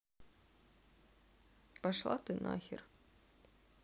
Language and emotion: Russian, sad